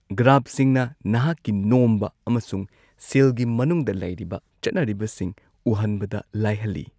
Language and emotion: Manipuri, neutral